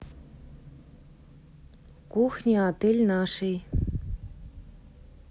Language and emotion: Russian, neutral